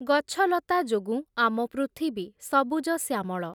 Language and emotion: Odia, neutral